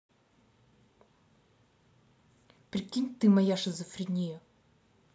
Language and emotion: Russian, angry